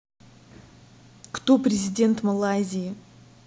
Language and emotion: Russian, angry